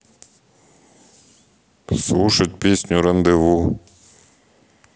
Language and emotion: Russian, neutral